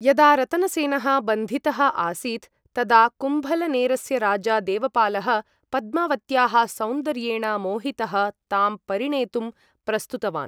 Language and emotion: Sanskrit, neutral